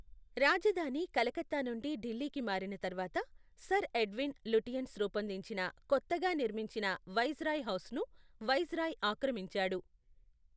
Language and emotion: Telugu, neutral